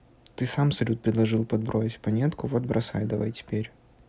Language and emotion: Russian, neutral